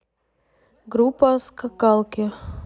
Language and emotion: Russian, neutral